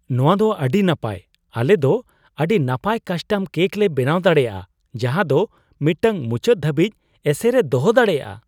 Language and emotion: Santali, surprised